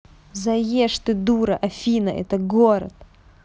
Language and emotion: Russian, angry